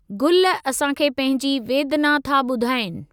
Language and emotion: Sindhi, neutral